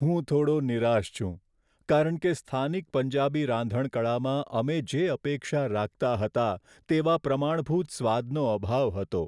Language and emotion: Gujarati, sad